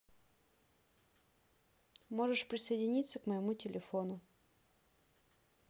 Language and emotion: Russian, neutral